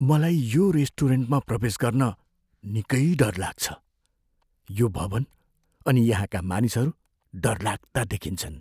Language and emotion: Nepali, fearful